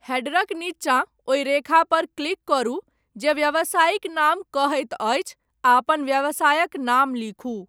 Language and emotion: Maithili, neutral